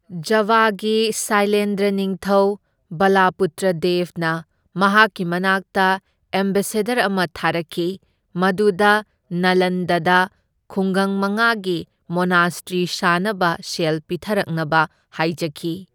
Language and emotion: Manipuri, neutral